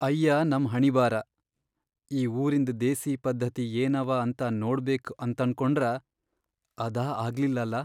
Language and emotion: Kannada, sad